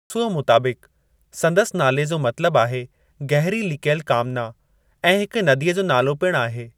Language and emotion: Sindhi, neutral